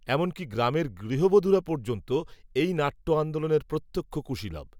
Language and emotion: Bengali, neutral